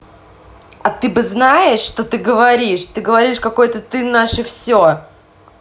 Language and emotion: Russian, angry